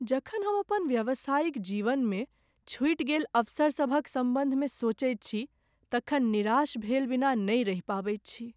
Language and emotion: Maithili, sad